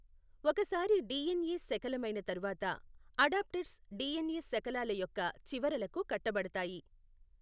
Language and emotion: Telugu, neutral